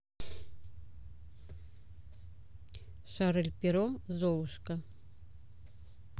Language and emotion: Russian, neutral